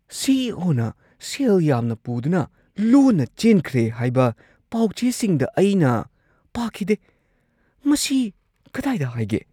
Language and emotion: Manipuri, surprised